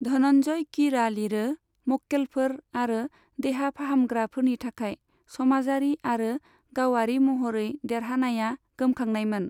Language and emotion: Bodo, neutral